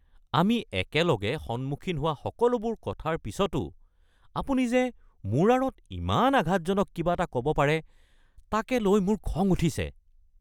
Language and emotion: Assamese, angry